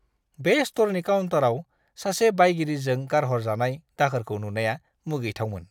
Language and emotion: Bodo, disgusted